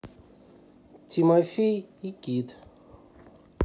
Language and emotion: Russian, neutral